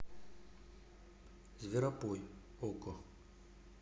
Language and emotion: Russian, neutral